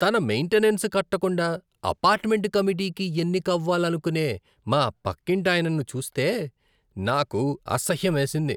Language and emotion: Telugu, disgusted